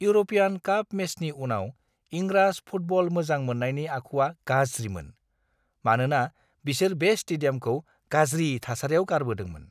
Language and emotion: Bodo, disgusted